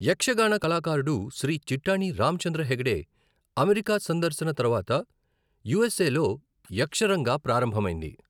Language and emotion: Telugu, neutral